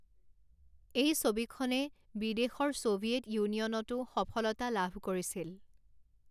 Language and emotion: Assamese, neutral